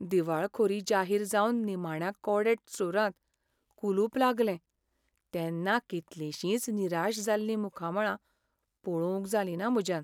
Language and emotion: Goan Konkani, sad